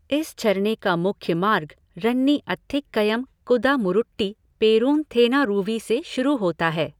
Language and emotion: Hindi, neutral